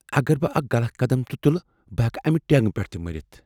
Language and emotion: Kashmiri, fearful